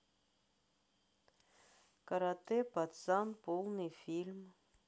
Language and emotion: Russian, neutral